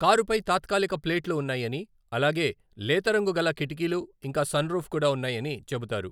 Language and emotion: Telugu, neutral